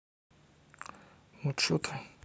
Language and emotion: Russian, neutral